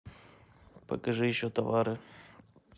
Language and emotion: Russian, neutral